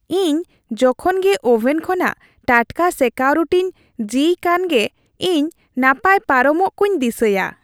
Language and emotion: Santali, happy